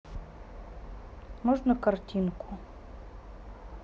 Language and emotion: Russian, neutral